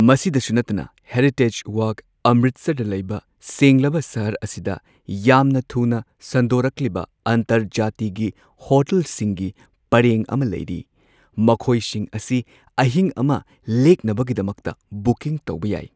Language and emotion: Manipuri, neutral